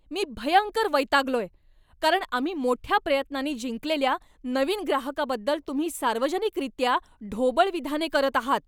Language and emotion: Marathi, angry